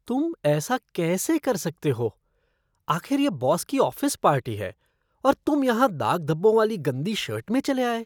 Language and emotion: Hindi, disgusted